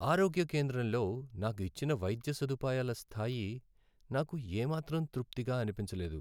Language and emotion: Telugu, sad